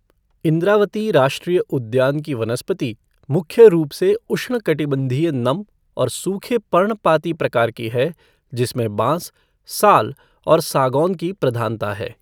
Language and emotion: Hindi, neutral